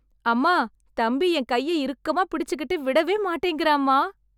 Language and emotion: Tamil, happy